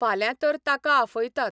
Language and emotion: Goan Konkani, neutral